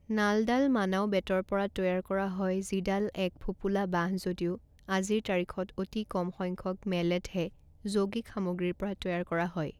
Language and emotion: Assamese, neutral